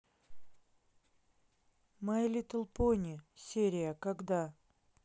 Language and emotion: Russian, neutral